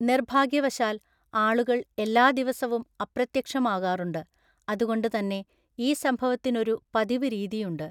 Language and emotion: Malayalam, neutral